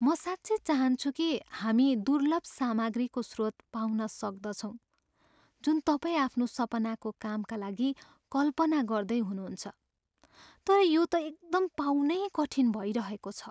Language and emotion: Nepali, sad